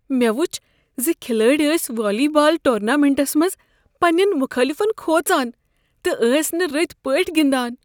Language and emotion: Kashmiri, fearful